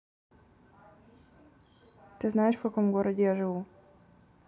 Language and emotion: Russian, neutral